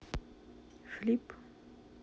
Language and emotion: Russian, neutral